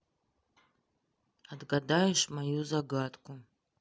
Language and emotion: Russian, sad